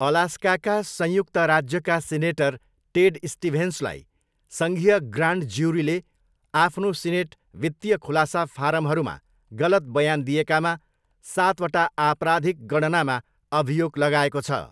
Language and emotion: Nepali, neutral